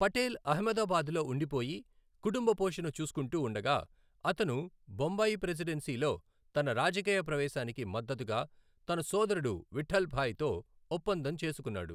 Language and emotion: Telugu, neutral